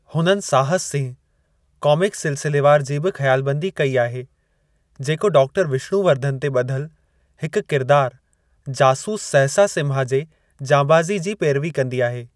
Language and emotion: Sindhi, neutral